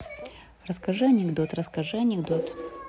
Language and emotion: Russian, neutral